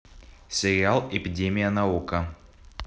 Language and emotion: Russian, neutral